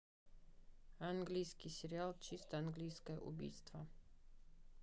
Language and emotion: Russian, neutral